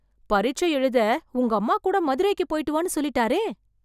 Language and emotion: Tamil, surprised